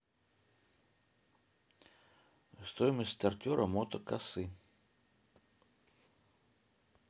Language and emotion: Russian, neutral